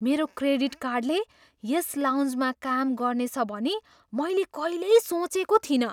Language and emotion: Nepali, surprised